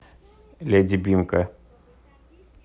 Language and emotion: Russian, neutral